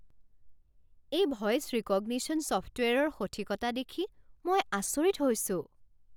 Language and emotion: Assamese, surprised